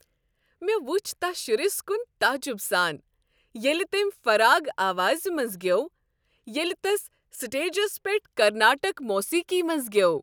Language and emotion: Kashmiri, happy